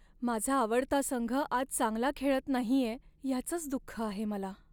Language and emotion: Marathi, sad